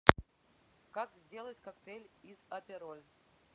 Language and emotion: Russian, neutral